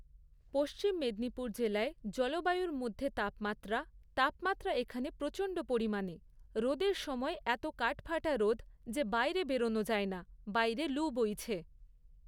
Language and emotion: Bengali, neutral